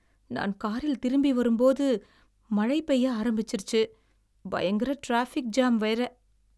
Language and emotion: Tamil, sad